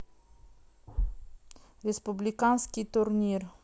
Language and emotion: Russian, neutral